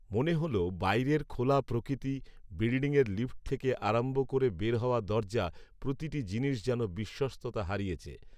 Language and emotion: Bengali, neutral